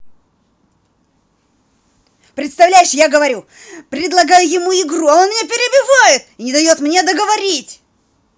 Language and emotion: Russian, angry